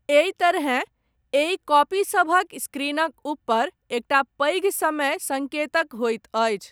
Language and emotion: Maithili, neutral